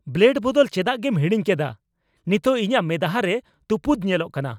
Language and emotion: Santali, angry